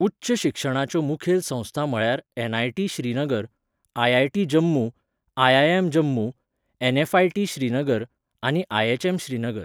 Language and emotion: Goan Konkani, neutral